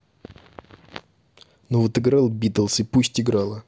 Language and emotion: Russian, angry